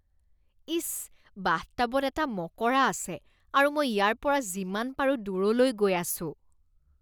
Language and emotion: Assamese, disgusted